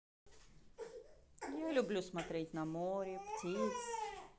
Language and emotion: Russian, positive